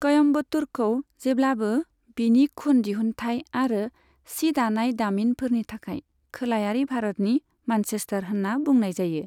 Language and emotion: Bodo, neutral